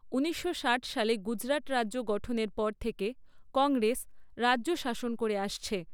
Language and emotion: Bengali, neutral